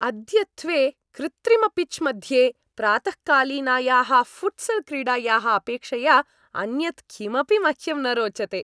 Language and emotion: Sanskrit, happy